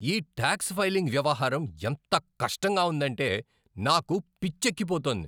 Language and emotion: Telugu, angry